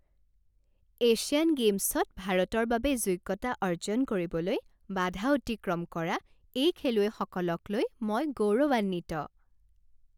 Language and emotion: Assamese, happy